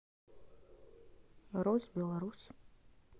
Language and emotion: Russian, neutral